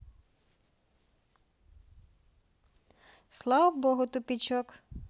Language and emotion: Russian, neutral